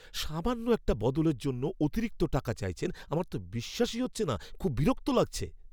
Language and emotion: Bengali, angry